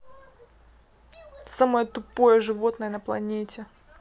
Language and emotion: Russian, angry